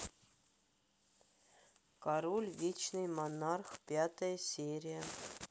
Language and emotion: Russian, neutral